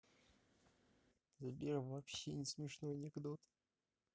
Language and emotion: Russian, neutral